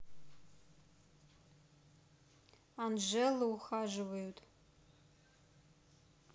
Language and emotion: Russian, neutral